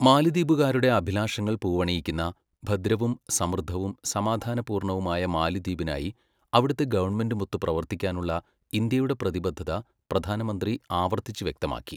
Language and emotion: Malayalam, neutral